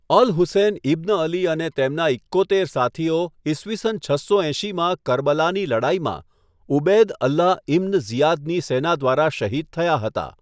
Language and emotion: Gujarati, neutral